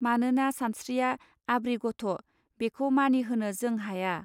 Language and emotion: Bodo, neutral